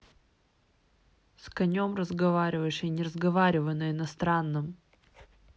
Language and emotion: Russian, angry